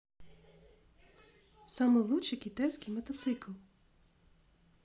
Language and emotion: Russian, neutral